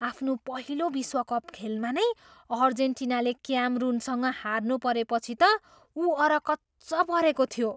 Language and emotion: Nepali, surprised